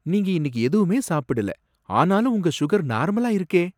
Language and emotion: Tamil, surprised